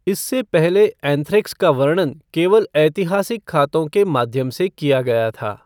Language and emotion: Hindi, neutral